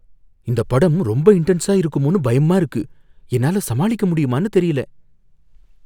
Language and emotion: Tamil, fearful